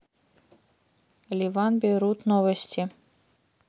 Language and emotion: Russian, neutral